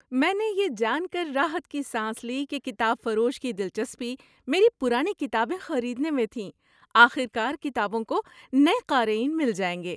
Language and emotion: Urdu, happy